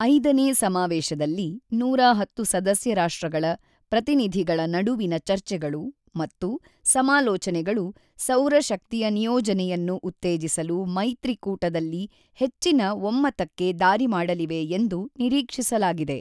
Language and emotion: Kannada, neutral